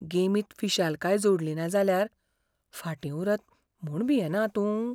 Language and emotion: Goan Konkani, fearful